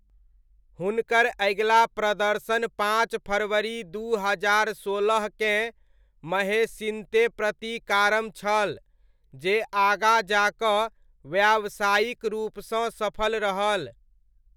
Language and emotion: Maithili, neutral